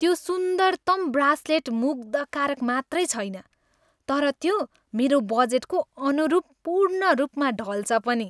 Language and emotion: Nepali, happy